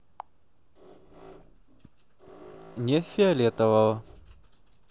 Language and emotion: Russian, neutral